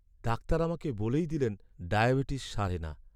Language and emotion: Bengali, sad